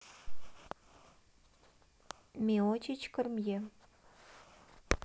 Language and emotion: Russian, neutral